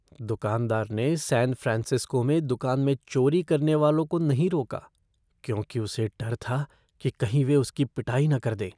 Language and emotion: Hindi, fearful